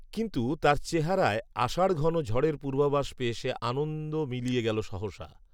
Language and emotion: Bengali, neutral